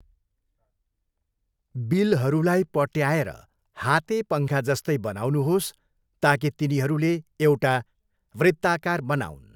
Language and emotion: Nepali, neutral